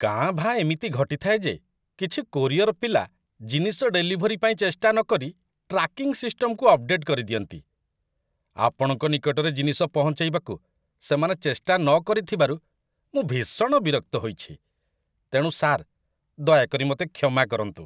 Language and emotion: Odia, disgusted